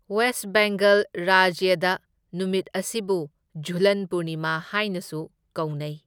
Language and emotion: Manipuri, neutral